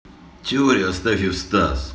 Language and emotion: Russian, neutral